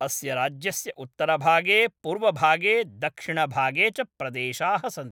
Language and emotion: Sanskrit, neutral